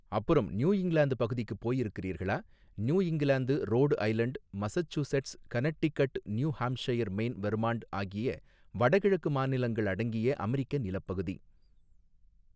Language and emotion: Tamil, neutral